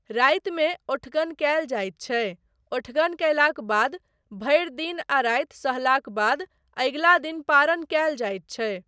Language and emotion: Maithili, neutral